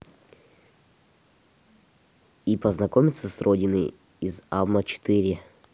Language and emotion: Russian, neutral